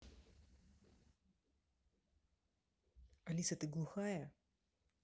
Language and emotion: Russian, angry